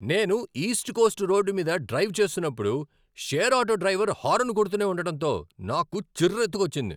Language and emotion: Telugu, angry